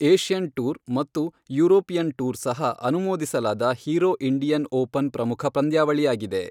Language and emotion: Kannada, neutral